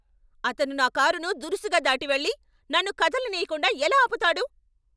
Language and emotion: Telugu, angry